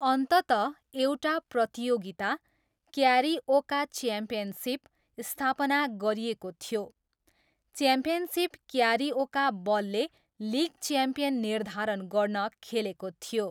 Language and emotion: Nepali, neutral